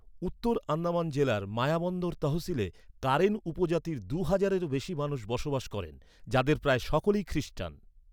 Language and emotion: Bengali, neutral